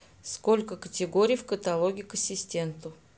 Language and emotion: Russian, neutral